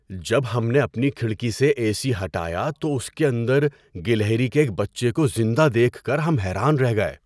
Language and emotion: Urdu, surprised